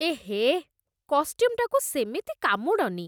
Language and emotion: Odia, disgusted